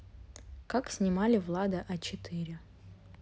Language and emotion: Russian, neutral